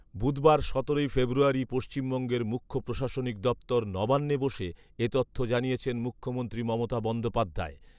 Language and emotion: Bengali, neutral